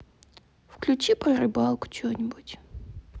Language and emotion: Russian, sad